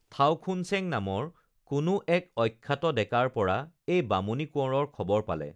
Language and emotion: Assamese, neutral